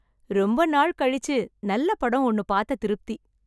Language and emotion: Tamil, happy